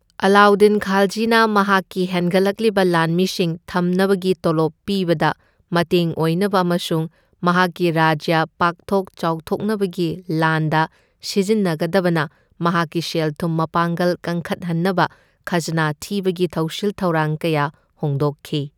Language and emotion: Manipuri, neutral